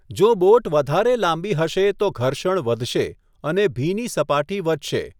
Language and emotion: Gujarati, neutral